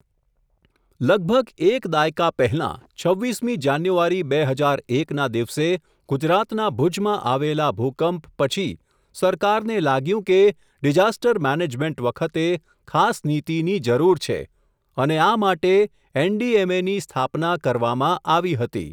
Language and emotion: Gujarati, neutral